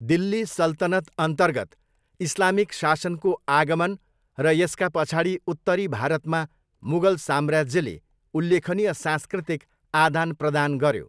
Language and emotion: Nepali, neutral